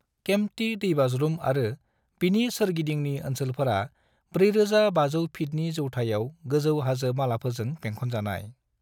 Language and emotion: Bodo, neutral